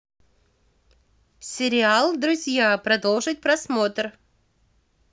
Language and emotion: Russian, positive